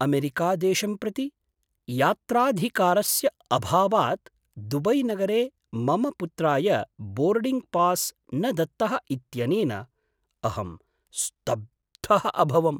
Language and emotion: Sanskrit, surprised